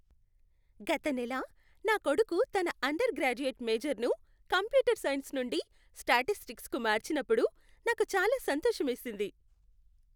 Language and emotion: Telugu, happy